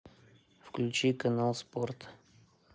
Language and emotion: Russian, neutral